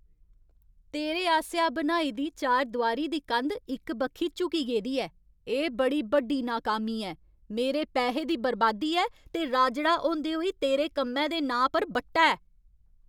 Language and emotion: Dogri, angry